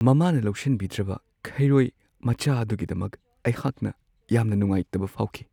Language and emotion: Manipuri, sad